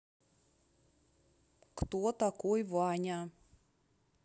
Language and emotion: Russian, neutral